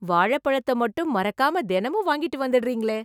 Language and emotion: Tamil, surprised